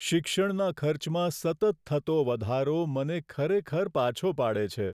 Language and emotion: Gujarati, sad